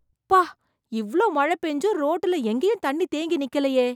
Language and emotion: Tamil, surprised